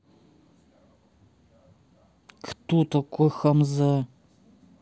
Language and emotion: Russian, angry